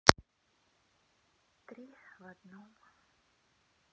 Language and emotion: Russian, sad